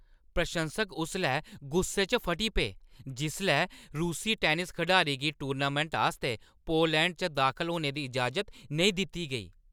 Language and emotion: Dogri, angry